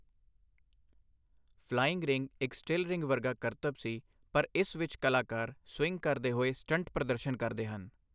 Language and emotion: Punjabi, neutral